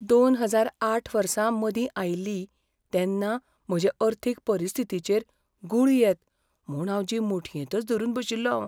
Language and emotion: Goan Konkani, fearful